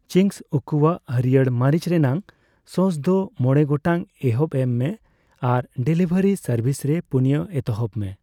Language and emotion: Santali, neutral